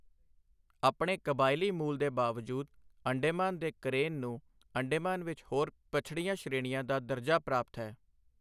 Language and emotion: Punjabi, neutral